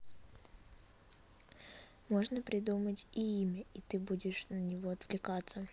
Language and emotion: Russian, neutral